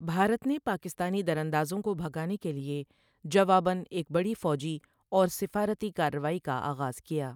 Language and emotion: Urdu, neutral